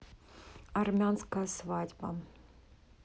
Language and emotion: Russian, neutral